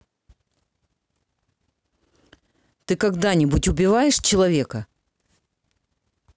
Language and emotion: Russian, angry